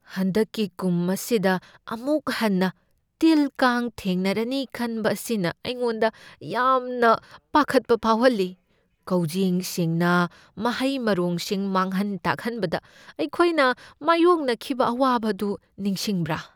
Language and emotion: Manipuri, fearful